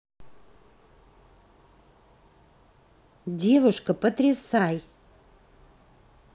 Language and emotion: Russian, positive